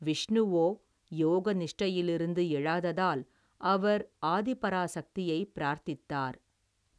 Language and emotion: Tamil, neutral